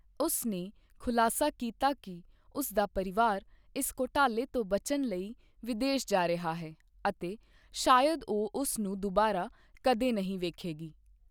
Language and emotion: Punjabi, neutral